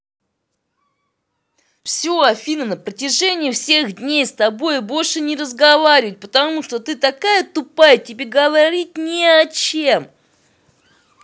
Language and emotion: Russian, angry